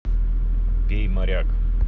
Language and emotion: Russian, neutral